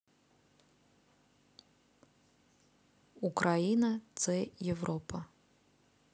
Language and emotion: Russian, neutral